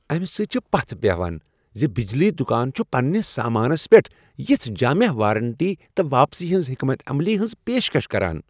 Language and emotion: Kashmiri, happy